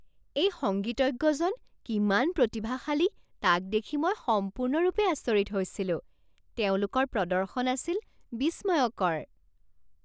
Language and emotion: Assamese, surprised